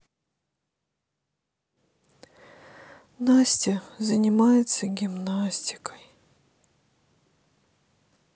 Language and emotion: Russian, sad